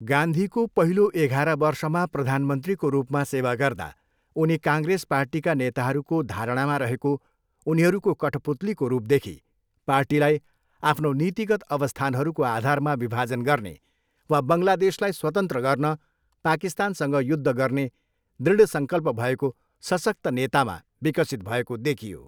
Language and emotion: Nepali, neutral